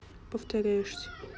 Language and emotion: Russian, neutral